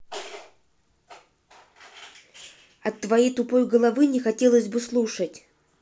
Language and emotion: Russian, angry